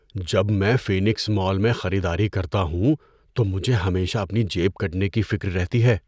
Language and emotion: Urdu, fearful